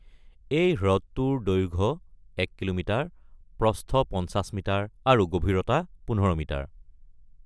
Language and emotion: Assamese, neutral